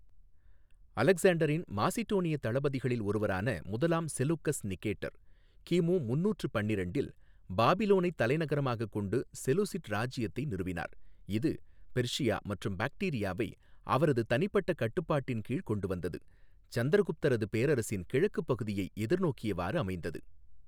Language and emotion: Tamil, neutral